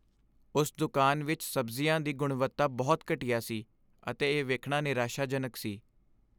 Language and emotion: Punjabi, sad